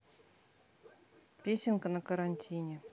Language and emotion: Russian, neutral